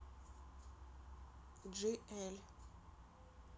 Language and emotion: Russian, neutral